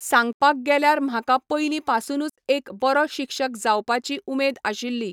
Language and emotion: Goan Konkani, neutral